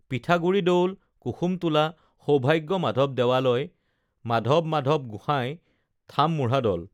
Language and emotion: Assamese, neutral